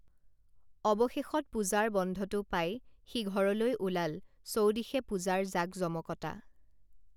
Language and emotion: Assamese, neutral